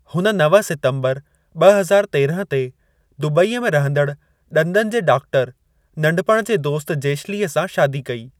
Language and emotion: Sindhi, neutral